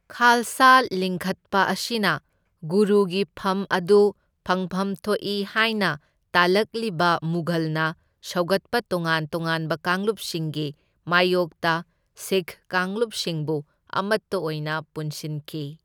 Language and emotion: Manipuri, neutral